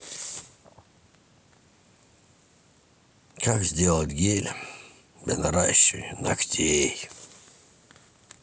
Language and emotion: Russian, sad